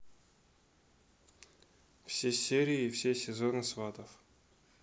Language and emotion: Russian, neutral